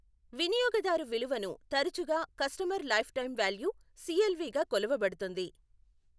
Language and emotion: Telugu, neutral